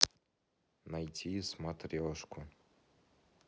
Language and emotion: Russian, sad